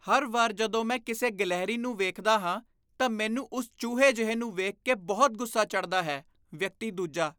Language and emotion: Punjabi, disgusted